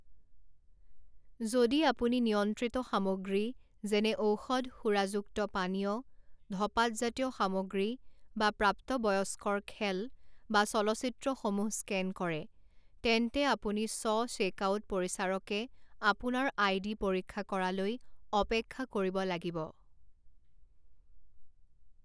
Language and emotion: Assamese, neutral